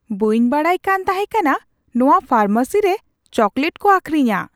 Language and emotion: Santali, surprised